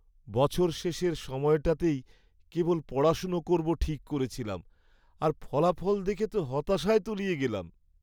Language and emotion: Bengali, sad